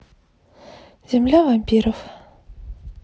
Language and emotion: Russian, sad